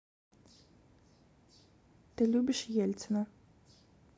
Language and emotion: Russian, neutral